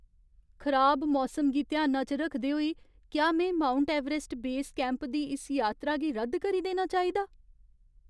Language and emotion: Dogri, fearful